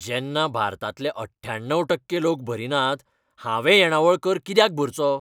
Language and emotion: Goan Konkani, angry